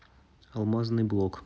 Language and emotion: Russian, neutral